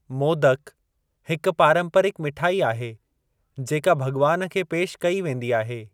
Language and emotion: Sindhi, neutral